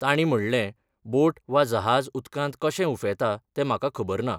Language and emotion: Goan Konkani, neutral